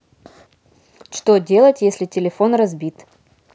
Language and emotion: Russian, neutral